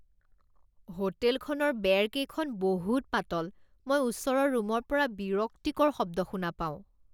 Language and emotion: Assamese, disgusted